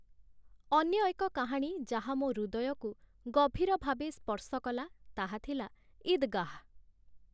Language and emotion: Odia, neutral